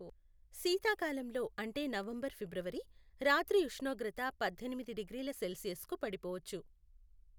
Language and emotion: Telugu, neutral